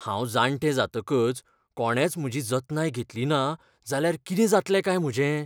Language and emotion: Goan Konkani, fearful